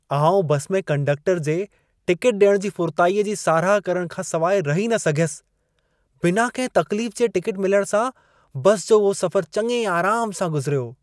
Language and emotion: Sindhi, happy